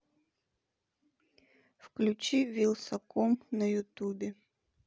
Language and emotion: Russian, neutral